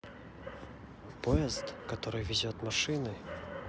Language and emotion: Russian, neutral